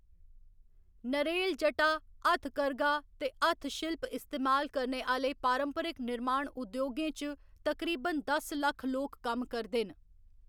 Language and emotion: Dogri, neutral